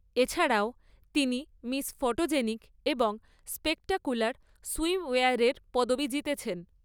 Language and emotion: Bengali, neutral